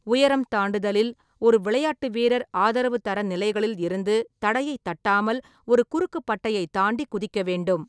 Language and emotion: Tamil, neutral